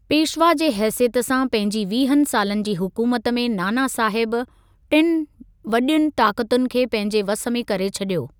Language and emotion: Sindhi, neutral